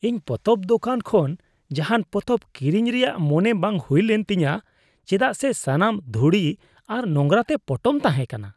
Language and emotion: Santali, disgusted